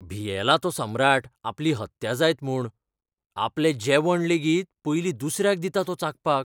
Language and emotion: Goan Konkani, fearful